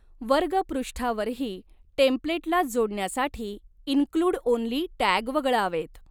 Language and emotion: Marathi, neutral